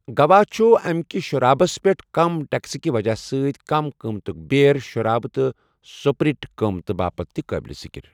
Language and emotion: Kashmiri, neutral